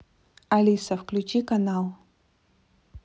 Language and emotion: Russian, neutral